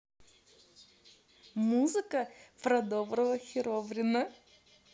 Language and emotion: Russian, positive